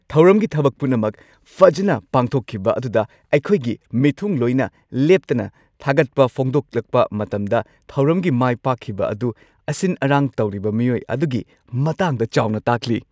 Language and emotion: Manipuri, happy